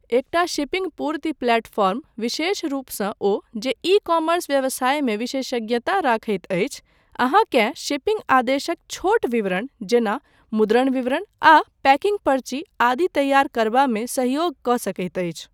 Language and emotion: Maithili, neutral